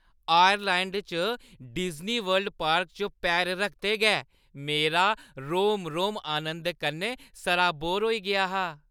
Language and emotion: Dogri, happy